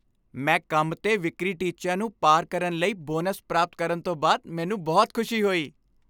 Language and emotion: Punjabi, happy